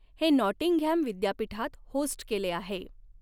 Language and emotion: Marathi, neutral